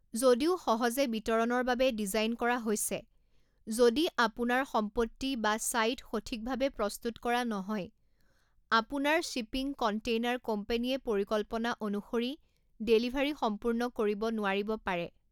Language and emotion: Assamese, neutral